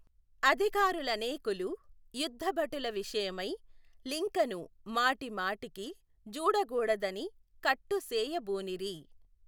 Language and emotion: Telugu, neutral